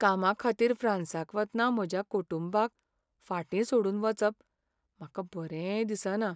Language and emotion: Goan Konkani, sad